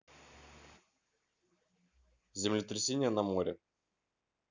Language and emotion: Russian, neutral